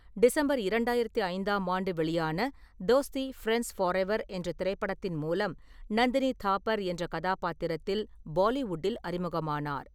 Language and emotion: Tamil, neutral